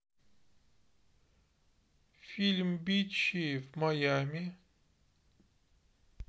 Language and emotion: Russian, neutral